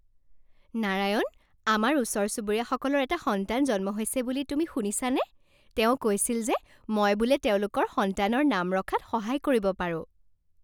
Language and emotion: Assamese, happy